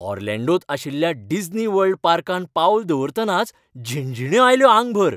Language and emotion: Goan Konkani, happy